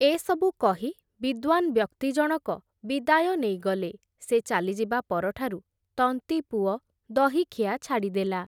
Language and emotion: Odia, neutral